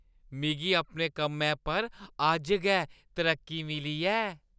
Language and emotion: Dogri, happy